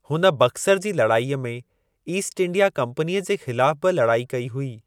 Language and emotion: Sindhi, neutral